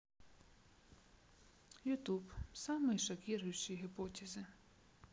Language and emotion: Russian, neutral